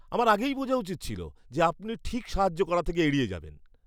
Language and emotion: Bengali, disgusted